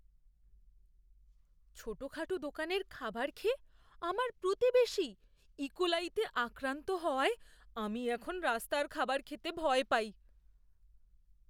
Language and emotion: Bengali, fearful